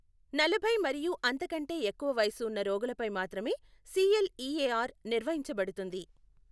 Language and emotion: Telugu, neutral